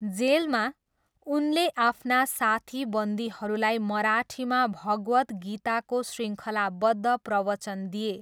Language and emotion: Nepali, neutral